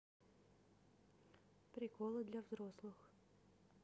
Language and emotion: Russian, neutral